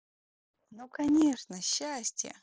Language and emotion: Russian, positive